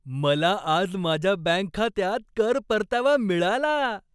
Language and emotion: Marathi, happy